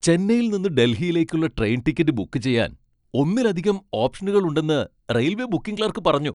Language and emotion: Malayalam, happy